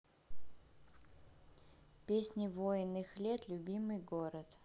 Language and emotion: Russian, neutral